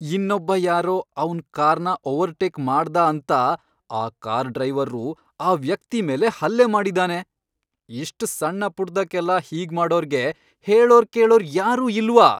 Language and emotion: Kannada, angry